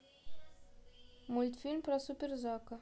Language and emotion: Russian, neutral